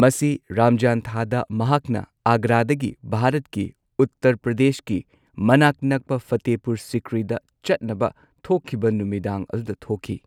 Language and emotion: Manipuri, neutral